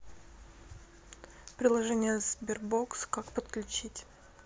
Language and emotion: Russian, neutral